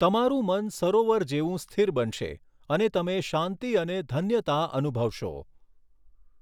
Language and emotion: Gujarati, neutral